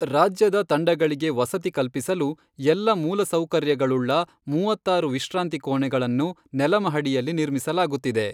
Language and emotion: Kannada, neutral